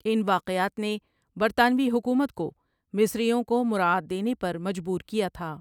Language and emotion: Urdu, neutral